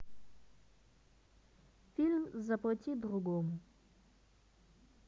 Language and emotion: Russian, neutral